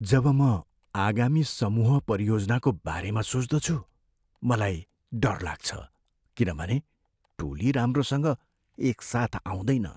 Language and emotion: Nepali, fearful